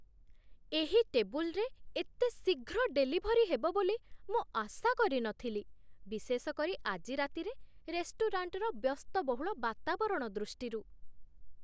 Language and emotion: Odia, surprised